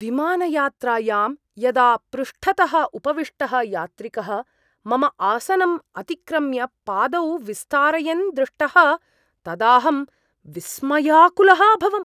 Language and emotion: Sanskrit, surprised